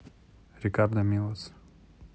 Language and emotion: Russian, neutral